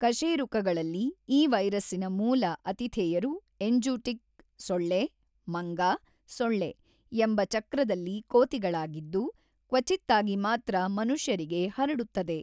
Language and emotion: Kannada, neutral